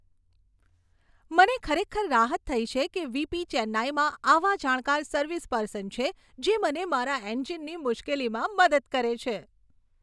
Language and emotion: Gujarati, happy